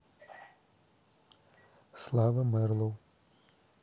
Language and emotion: Russian, neutral